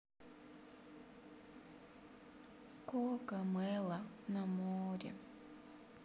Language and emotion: Russian, sad